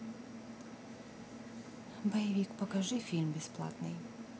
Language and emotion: Russian, neutral